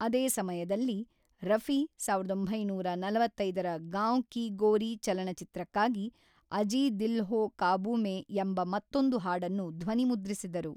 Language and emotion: Kannada, neutral